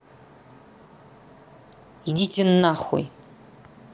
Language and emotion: Russian, angry